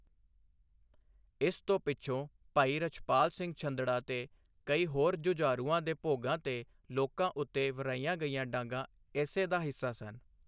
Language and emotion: Punjabi, neutral